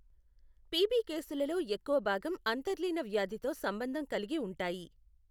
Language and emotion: Telugu, neutral